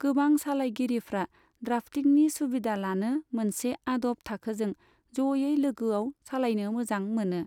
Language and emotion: Bodo, neutral